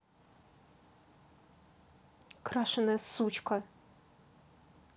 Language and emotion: Russian, angry